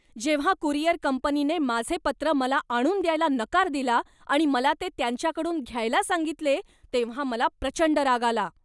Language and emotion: Marathi, angry